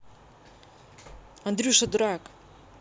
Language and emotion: Russian, positive